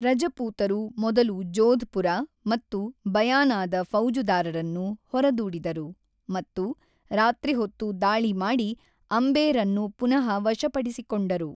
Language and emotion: Kannada, neutral